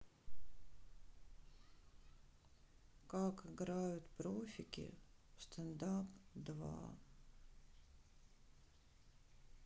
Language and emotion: Russian, sad